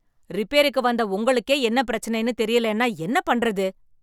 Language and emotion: Tamil, angry